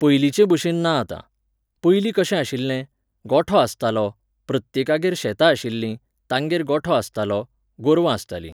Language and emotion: Goan Konkani, neutral